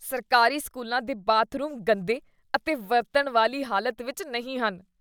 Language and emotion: Punjabi, disgusted